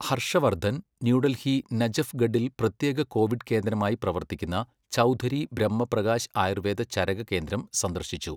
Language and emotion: Malayalam, neutral